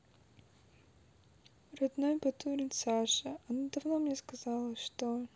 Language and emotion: Russian, sad